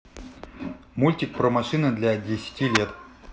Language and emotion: Russian, neutral